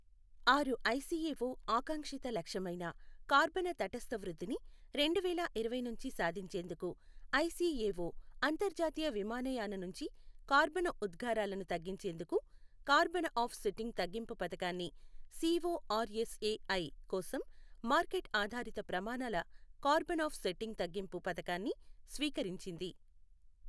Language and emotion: Telugu, neutral